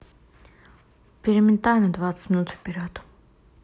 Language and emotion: Russian, neutral